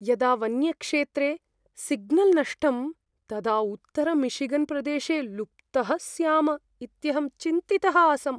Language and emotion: Sanskrit, fearful